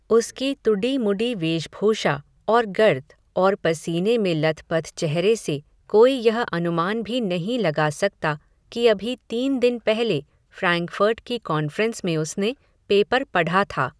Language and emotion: Hindi, neutral